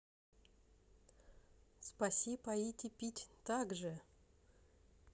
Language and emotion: Russian, positive